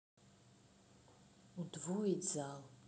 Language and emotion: Russian, neutral